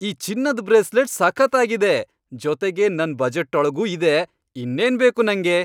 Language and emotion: Kannada, happy